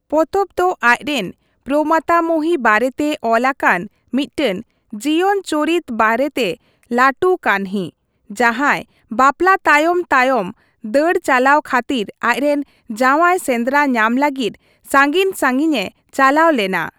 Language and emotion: Santali, neutral